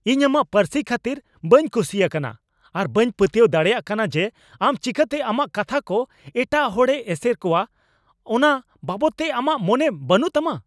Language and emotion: Santali, angry